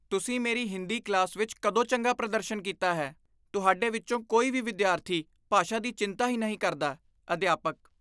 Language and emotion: Punjabi, disgusted